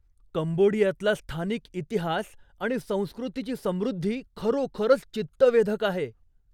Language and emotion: Marathi, surprised